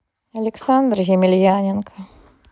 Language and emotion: Russian, sad